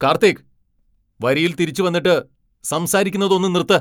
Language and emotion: Malayalam, angry